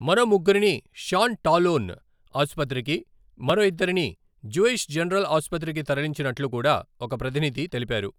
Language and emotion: Telugu, neutral